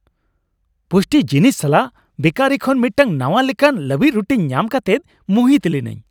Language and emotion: Santali, happy